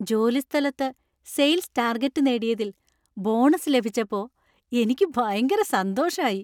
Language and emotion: Malayalam, happy